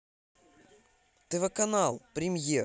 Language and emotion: Russian, positive